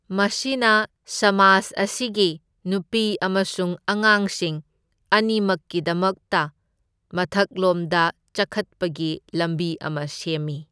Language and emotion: Manipuri, neutral